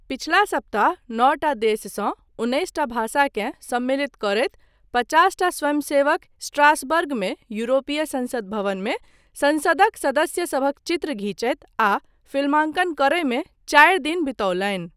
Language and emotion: Maithili, neutral